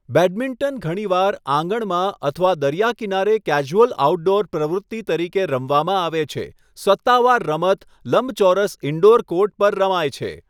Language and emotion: Gujarati, neutral